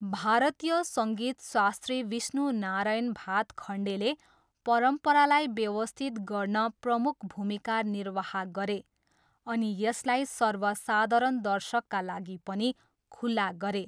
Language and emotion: Nepali, neutral